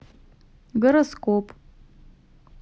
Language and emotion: Russian, neutral